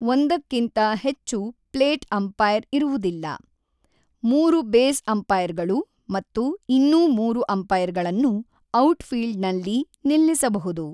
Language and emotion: Kannada, neutral